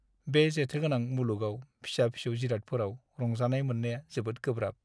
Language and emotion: Bodo, sad